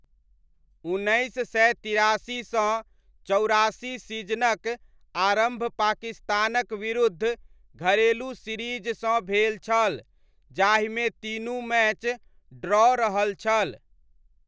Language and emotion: Maithili, neutral